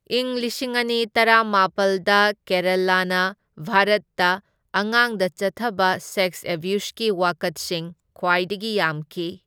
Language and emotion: Manipuri, neutral